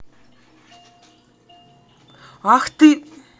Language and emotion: Russian, angry